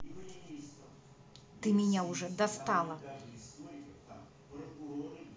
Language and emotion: Russian, angry